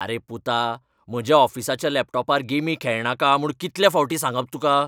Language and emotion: Goan Konkani, angry